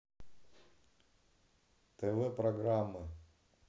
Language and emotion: Russian, neutral